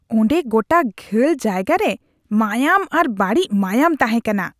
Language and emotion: Santali, disgusted